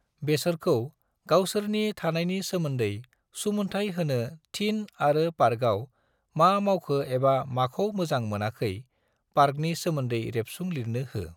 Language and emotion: Bodo, neutral